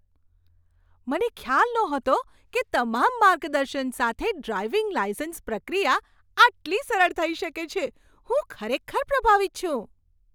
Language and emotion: Gujarati, surprised